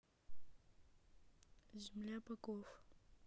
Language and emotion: Russian, neutral